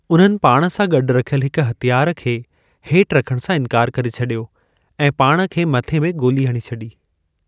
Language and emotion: Sindhi, neutral